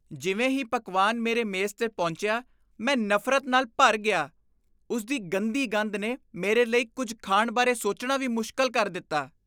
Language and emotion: Punjabi, disgusted